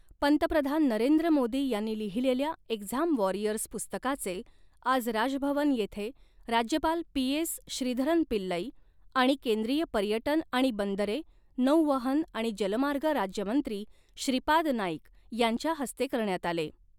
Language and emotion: Marathi, neutral